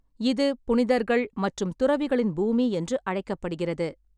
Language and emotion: Tamil, neutral